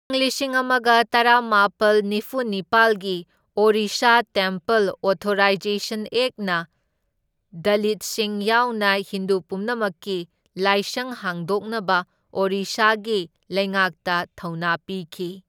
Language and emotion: Manipuri, neutral